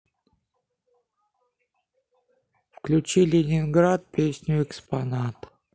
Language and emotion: Russian, neutral